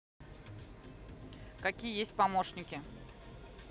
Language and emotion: Russian, neutral